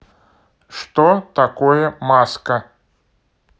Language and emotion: Russian, neutral